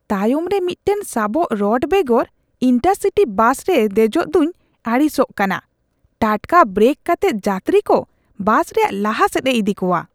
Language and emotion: Santali, disgusted